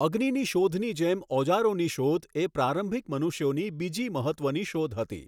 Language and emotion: Gujarati, neutral